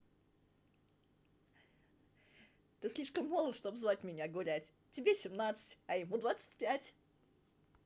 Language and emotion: Russian, positive